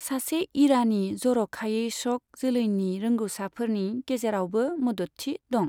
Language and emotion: Bodo, neutral